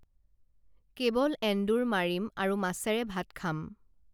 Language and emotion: Assamese, neutral